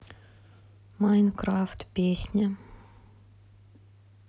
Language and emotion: Russian, sad